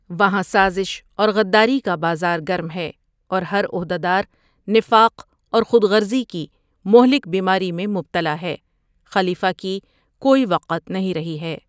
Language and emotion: Urdu, neutral